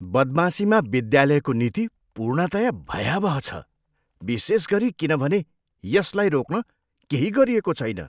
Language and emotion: Nepali, disgusted